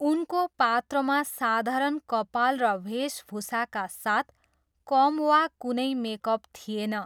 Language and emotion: Nepali, neutral